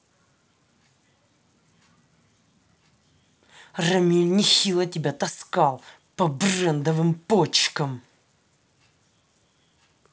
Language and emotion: Russian, angry